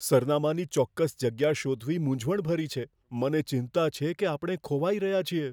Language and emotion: Gujarati, fearful